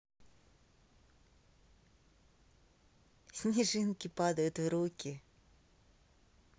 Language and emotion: Russian, positive